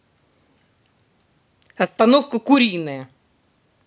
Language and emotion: Russian, angry